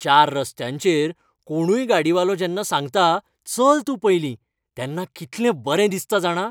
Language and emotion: Goan Konkani, happy